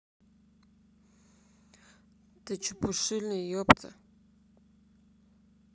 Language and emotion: Russian, neutral